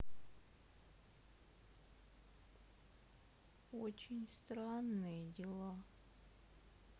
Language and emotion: Russian, sad